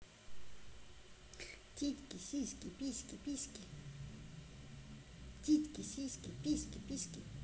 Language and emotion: Russian, positive